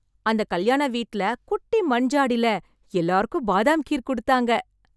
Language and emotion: Tamil, happy